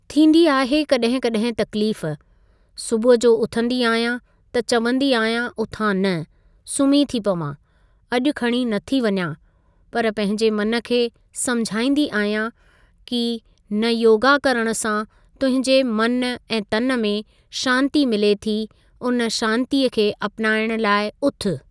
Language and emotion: Sindhi, neutral